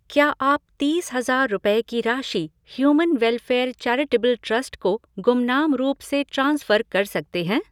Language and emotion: Hindi, neutral